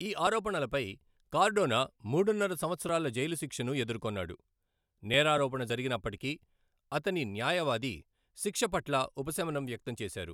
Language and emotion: Telugu, neutral